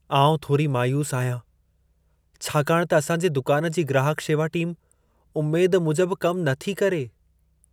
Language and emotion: Sindhi, sad